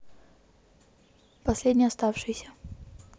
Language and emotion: Russian, neutral